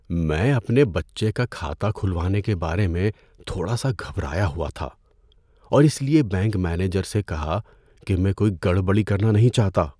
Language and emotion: Urdu, fearful